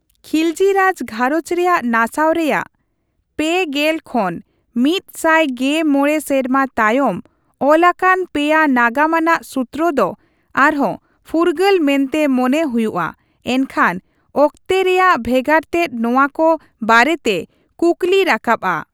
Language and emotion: Santali, neutral